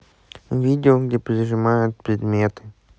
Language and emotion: Russian, neutral